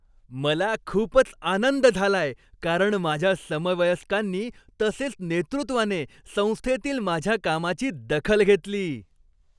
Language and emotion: Marathi, happy